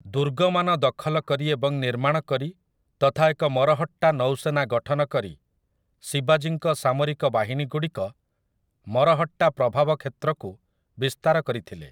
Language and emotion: Odia, neutral